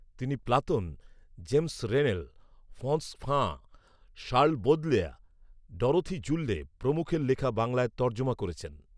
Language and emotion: Bengali, neutral